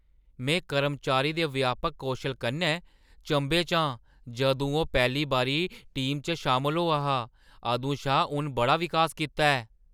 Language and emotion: Dogri, surprised